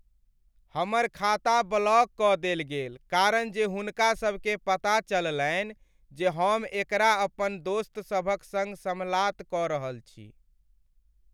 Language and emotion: Maithili, sad